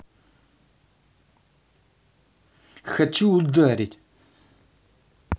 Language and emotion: Russian, angry